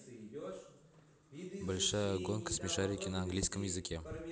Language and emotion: Russian, neutral